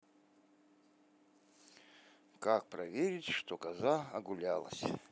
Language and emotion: Russian, neutral